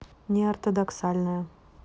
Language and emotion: Russian, neutral